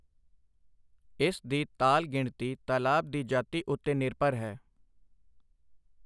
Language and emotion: Punjabi, neutral